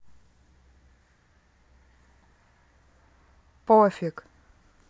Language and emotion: Russian, neutral